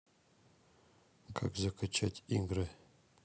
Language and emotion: Russian, neutral